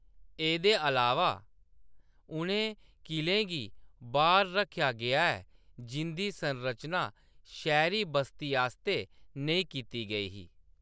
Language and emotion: Dogri, neutral